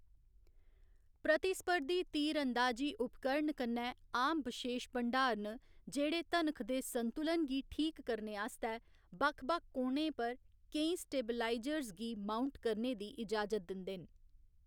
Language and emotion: Dogri, neutral